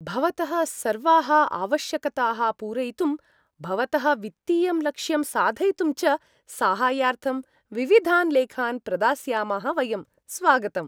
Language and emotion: Sanskrit, happy